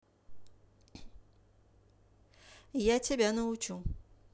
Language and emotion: Russian, neutral